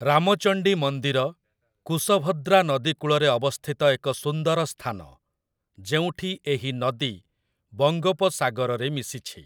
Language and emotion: Odia, neutral